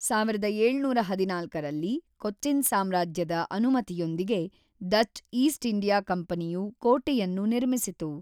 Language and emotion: Kannada, neutral